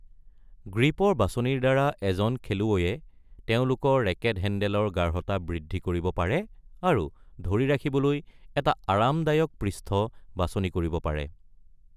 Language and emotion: Assamese, neutral